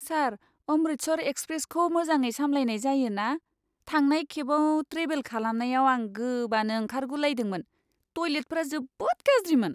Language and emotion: Bodo, disgusted